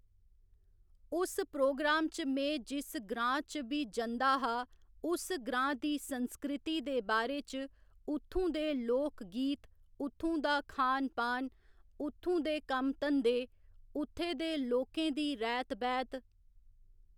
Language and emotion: Dogri, neutral